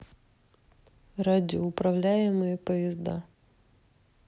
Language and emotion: Russian, neutral